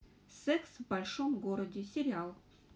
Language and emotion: Russian, neutral